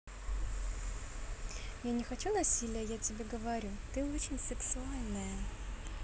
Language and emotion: Russian, positive